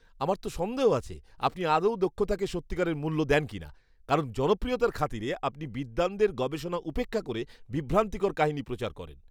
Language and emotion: Bengali, disgusted